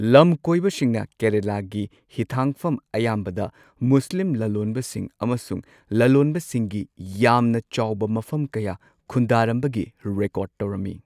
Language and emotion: Manipuri, neutral